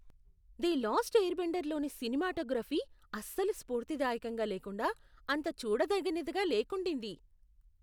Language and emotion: Telugu, disgusted